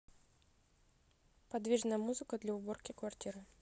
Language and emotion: Russian, neutral